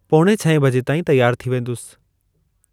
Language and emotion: Sindhi, neutral